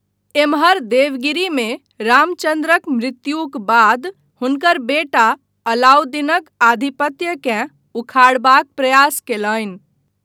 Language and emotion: Maithili, neutral